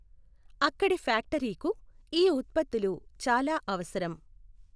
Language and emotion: Telugu, neutral